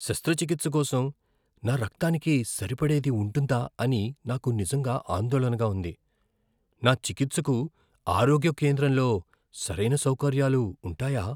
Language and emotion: Telugu, fearful